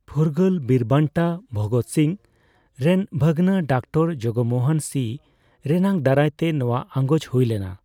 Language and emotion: Santali, neutral